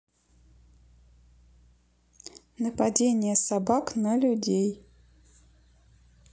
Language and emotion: Russian, neutral